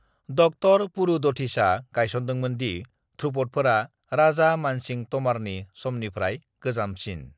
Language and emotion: Bodo, neutral